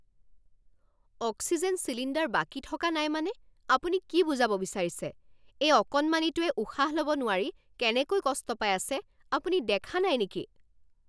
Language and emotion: Assamese, angry